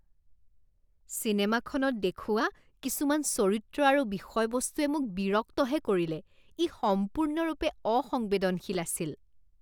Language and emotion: Assamese, disgusted